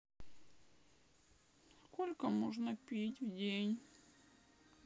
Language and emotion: Russian, sad